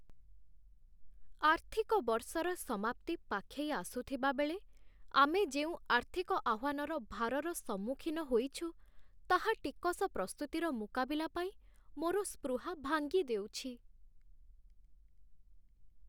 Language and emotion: Odia, sad